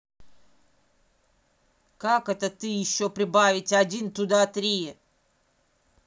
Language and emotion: Russian, angry